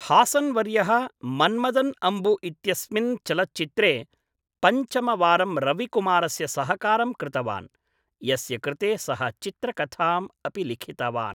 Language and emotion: Sanskrit, neutral